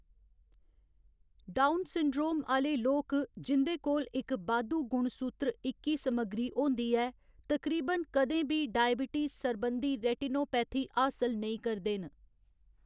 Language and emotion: Dogri, neutral